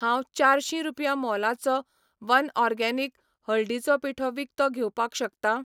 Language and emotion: Goan Konkani, neutral